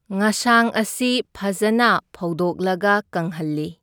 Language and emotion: Manipuri, neutral